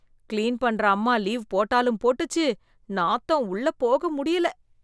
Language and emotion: Tamil, disgusted